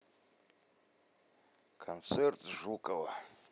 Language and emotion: Russian, neutral